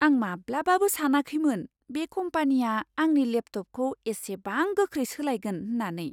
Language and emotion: Bodo, surprised